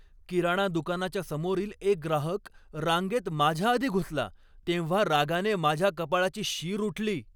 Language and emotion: Marathi, angry